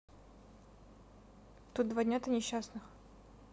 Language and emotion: Russian, neutral